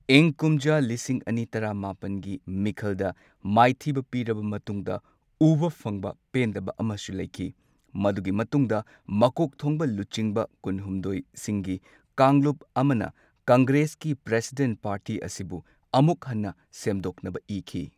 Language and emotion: Manipuri, neutral